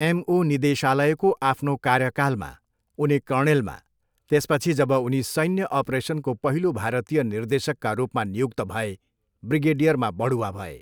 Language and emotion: Nepali, neutral